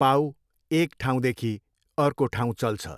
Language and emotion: Nepali, neutral